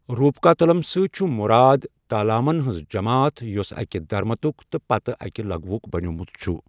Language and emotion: Kashmiri, neutral